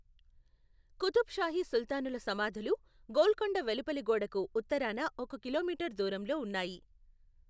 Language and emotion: Telugu, neutral